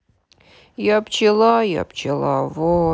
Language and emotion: Russian, sad